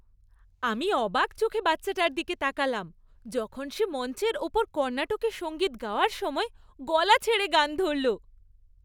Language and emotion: Bengali, happy